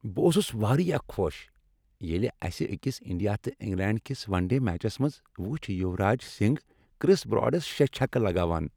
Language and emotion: Kashmiri, happy